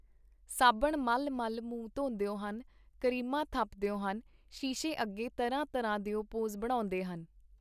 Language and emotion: Punjabi, neutral